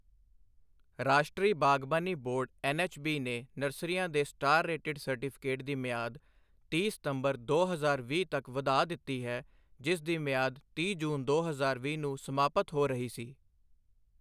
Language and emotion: Punjabi, neutral